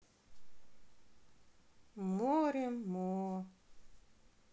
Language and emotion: Russian, sad